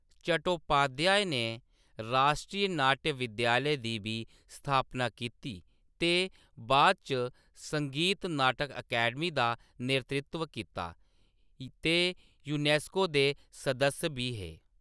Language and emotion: Dogri, neutral